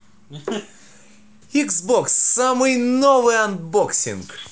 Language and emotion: Russian, positive